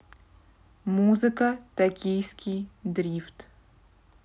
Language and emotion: Russian, neutral